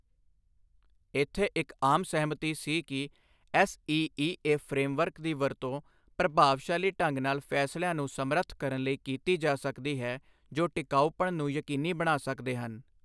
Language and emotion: Punjabi, neutral